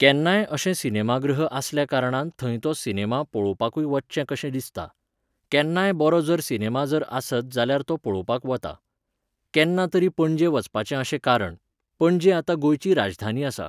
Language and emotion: Goan Konkani, neutral